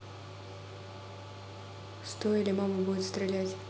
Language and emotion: Russian, neutral